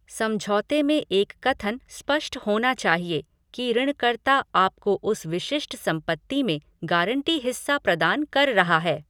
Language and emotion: Hindi, neutral